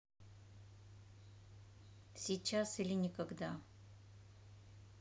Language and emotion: Russian, neutral